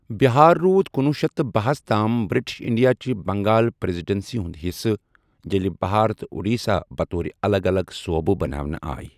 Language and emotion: Kashmiri, neutral